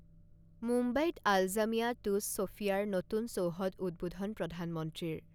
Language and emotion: Assamese, neutral